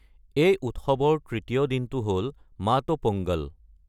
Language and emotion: Assamese, neutral